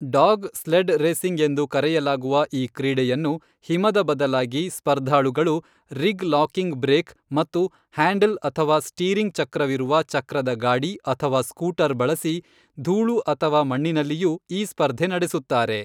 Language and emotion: Kannada, neutral